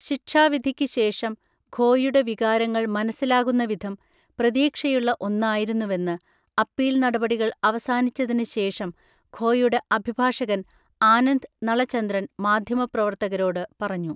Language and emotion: Malayalam, neutral